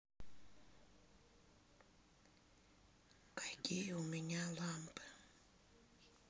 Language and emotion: Russian, neutral